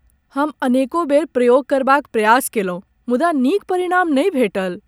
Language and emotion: Maithili, sad